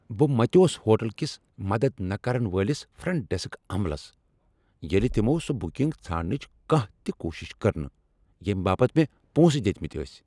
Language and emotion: Kashmiri, angry